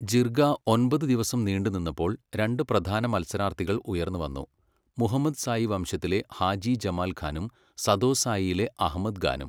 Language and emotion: Malayalam, neutral